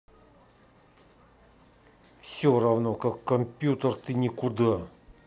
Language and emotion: Russian, angry